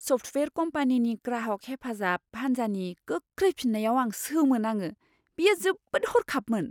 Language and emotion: Bodo, surprised